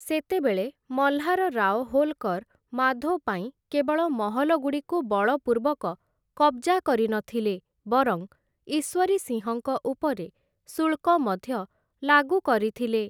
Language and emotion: Odia, neutral